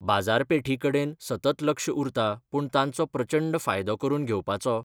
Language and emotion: Goan Konkani, neutral